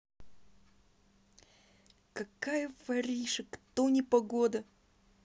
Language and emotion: Russian, angry